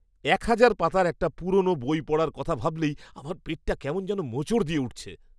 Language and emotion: Bengali, disgusted